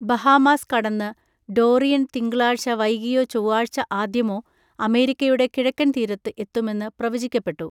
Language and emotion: Malayalam, neutral